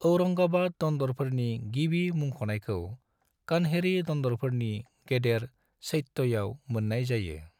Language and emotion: Bodo, neutral